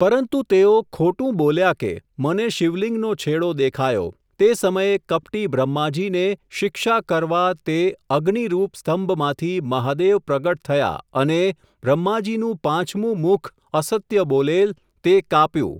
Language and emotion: Gujarati, neutral